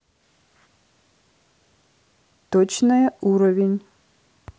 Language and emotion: Russian, neutral